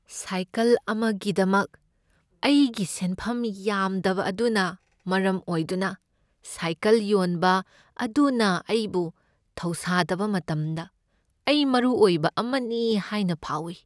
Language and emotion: Manipuri, sad